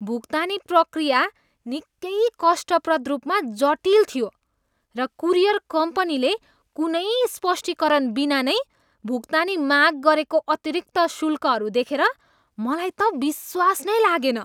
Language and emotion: Nepali, disgusted